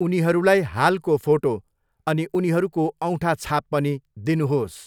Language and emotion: Nepali, neutral